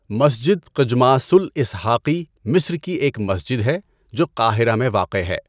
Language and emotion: Urdu, neutral